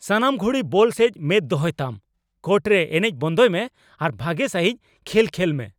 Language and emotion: Santali, angry